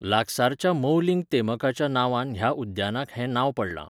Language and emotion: Goan Konkani, neutral